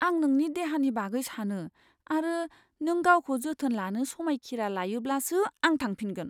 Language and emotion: Bodo, fearful